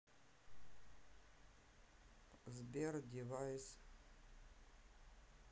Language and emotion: Russian, sad